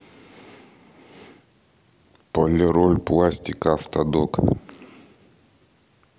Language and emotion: Russian, neutral